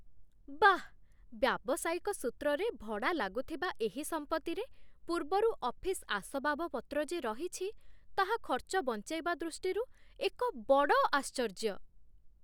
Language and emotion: Odia, surprised